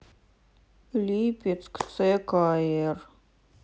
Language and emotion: Russian, sad